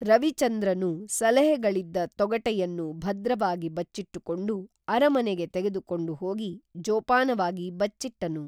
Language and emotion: Kannada, neutral